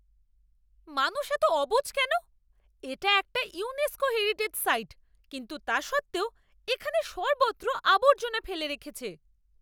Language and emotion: Bengali, angry